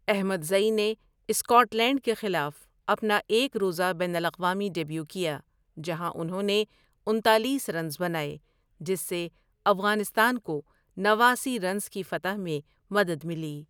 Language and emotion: Urdu, neutral